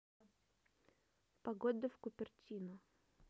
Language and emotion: Russian, neutral